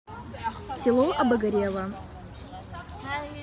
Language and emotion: Russian, neutral